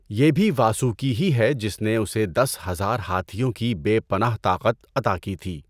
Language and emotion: Urdu, neutral